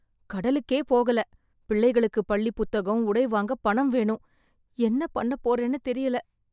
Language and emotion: Tamil, fearful